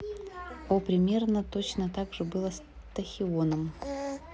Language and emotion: Russian, neutral